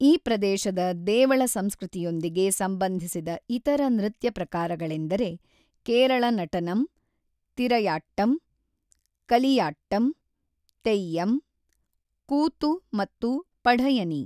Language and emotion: Kannada, neutral